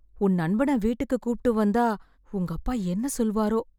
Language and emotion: Tamil, fearful